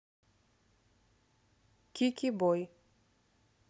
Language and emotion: Russian, neutral